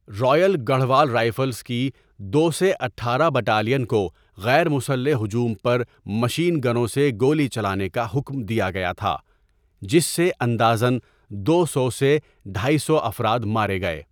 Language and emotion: Urdu, neutral